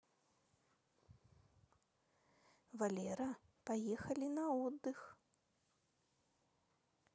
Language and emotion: Russian, neutral